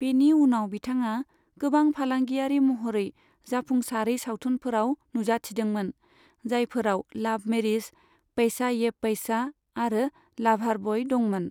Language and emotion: Bodo, neutral